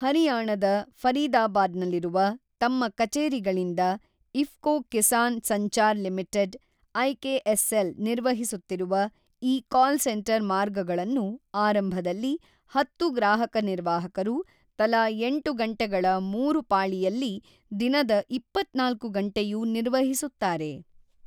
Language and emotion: Kannada, neutral